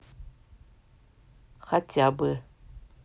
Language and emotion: Russian, neutral